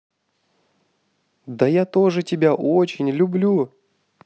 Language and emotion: Russian, positive